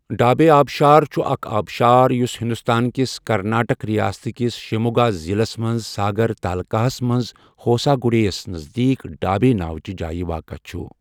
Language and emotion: Kashmiri, neutral